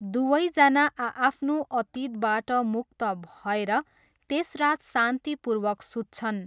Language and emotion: Nepali, neutral